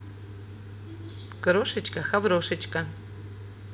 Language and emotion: Russian, positive